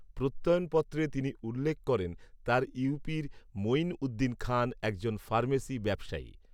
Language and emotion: Bengali, neutral